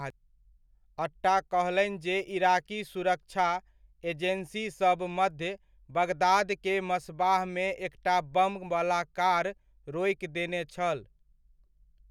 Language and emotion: Maithili, neutral